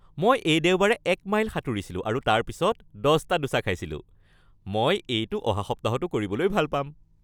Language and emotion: Assamese, happy